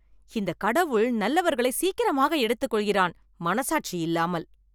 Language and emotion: Tamil, angry